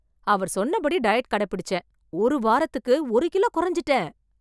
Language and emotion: Tamil, surprised